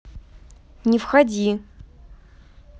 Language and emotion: Russian, neutral